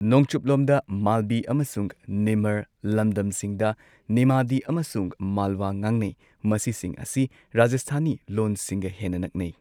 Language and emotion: Manipuri, neutral